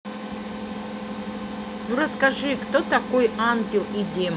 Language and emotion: Russian, neutral